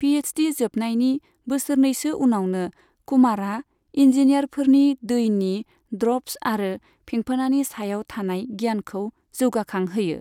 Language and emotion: Bodo, neutral